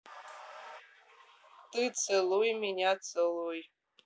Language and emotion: Russian, neutral